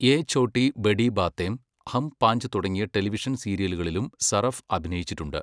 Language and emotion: Malayalam, neutral